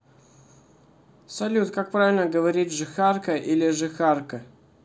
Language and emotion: Russian, neutral